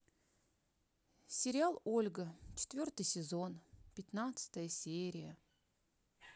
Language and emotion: Russian, sad